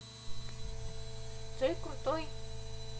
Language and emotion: Russian, positive